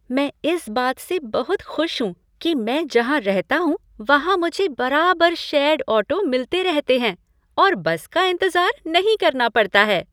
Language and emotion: Hindi, happy